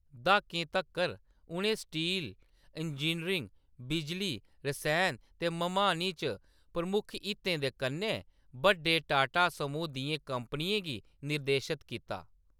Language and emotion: Dogri, neutral